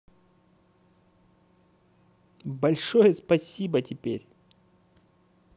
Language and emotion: Russian, positive